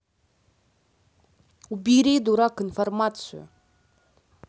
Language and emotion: Russian, angry